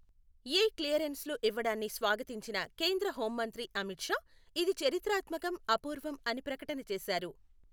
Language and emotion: Telugu, neutral